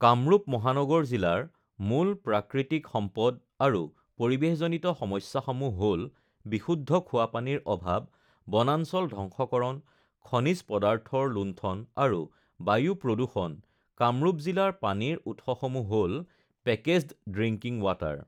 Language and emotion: Assamese, neutral